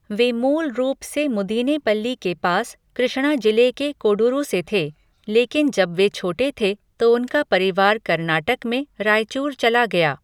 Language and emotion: Hindi, neutral